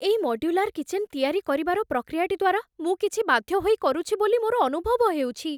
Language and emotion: Odia, fearful